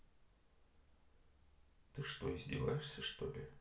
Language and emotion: Russian, neutral